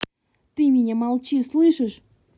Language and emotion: Russian, angry